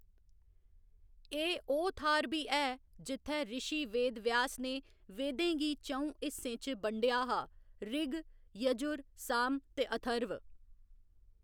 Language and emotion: Dogri, neutral